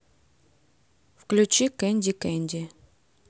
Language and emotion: Russian, neutral